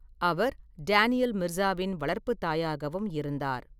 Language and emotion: Tamil, neutral